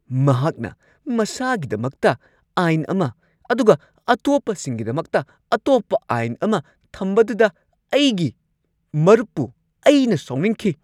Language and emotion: Manipuri, angry